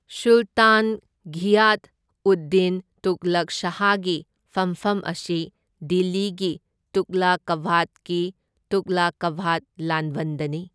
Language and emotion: Manipuri, neutral